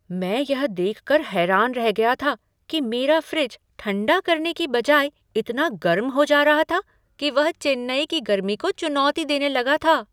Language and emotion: Hindi, surprised